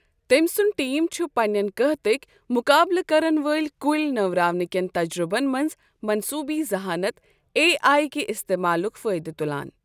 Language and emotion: Kashmiri, neutral